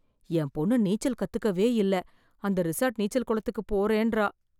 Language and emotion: Tamil, fearful